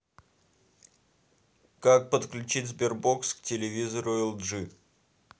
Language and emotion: Russian, neutral